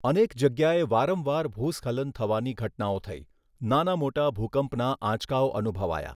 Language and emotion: Gujarati, neutral